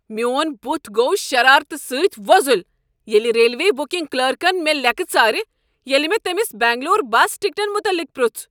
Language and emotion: Kashmiri, angry